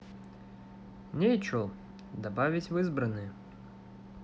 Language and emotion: Russian, neutral